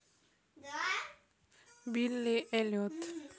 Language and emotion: Russian, neutral